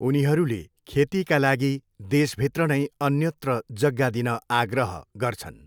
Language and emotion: Nepali, neutral